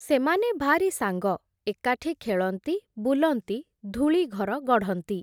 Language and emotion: Odia, neutral